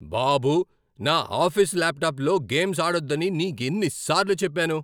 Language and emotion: Telugu, angry